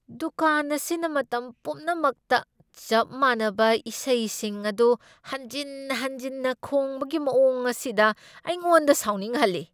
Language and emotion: Manipuri, angry